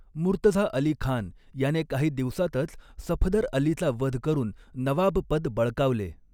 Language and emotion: Marathi, neutral